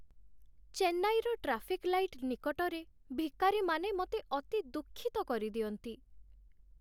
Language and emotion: Odia, sad